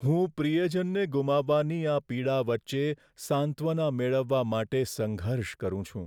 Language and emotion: Gujarati, sad